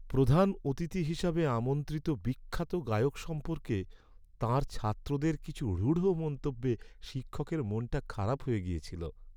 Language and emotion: Bengali, sad